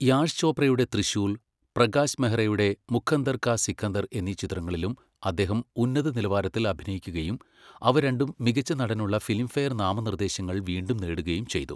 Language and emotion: Malayalam, neutral